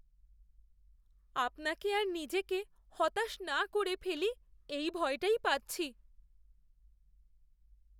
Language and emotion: Bengali, fearful